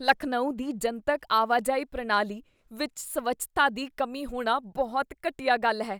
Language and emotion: Punjabi, disgusted